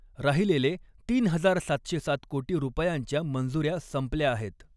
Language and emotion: Marathi, neutral